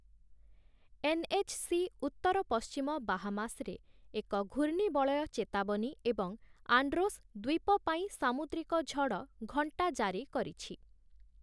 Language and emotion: Odia, neutral